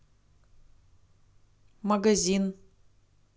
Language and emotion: Russian, neutral